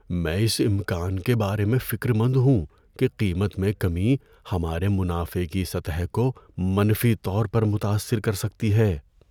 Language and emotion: Urdu, fearful